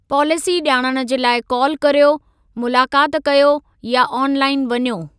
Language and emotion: Sindhi, neutral